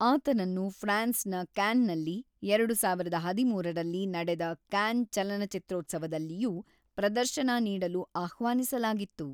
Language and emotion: Kannada, neutral